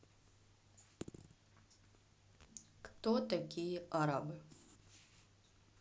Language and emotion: Russian, neutral